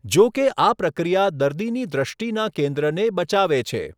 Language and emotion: Gujarati, neutral